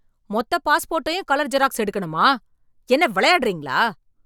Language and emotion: Tamil, angry